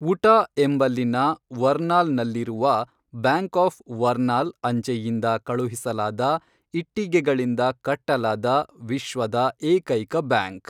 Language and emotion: Kannada, neutral